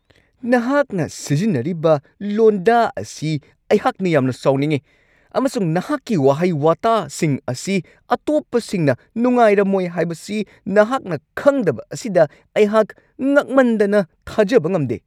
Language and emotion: Manipuri, angry